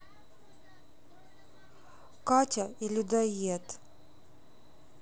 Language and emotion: Russian, sad